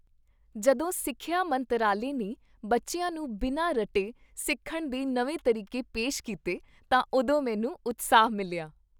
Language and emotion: Punjabi, happy